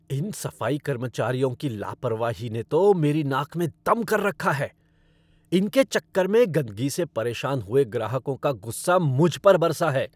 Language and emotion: Hindi, angry